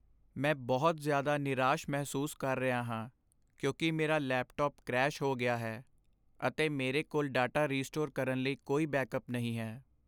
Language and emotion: Punjabi, sad